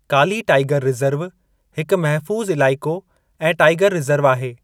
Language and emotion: Sindhi, neutral